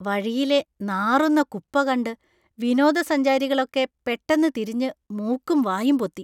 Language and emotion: Malayalam, disgusted